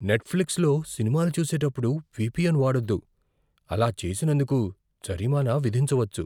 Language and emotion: Telugu, fearful